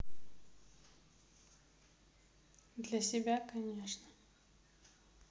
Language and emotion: Russian, neutral